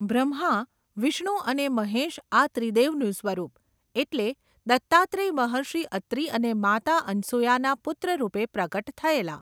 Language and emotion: Gujarati, neutral